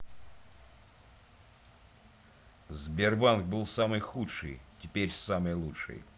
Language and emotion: Russian, angry